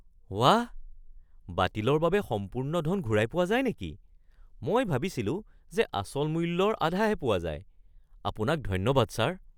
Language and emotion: Assamese, surprised